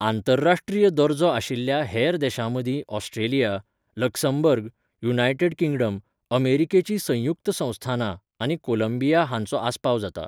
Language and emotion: Goan Konkani, neutral